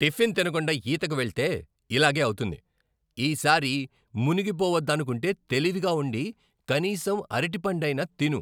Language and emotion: Telugu, angry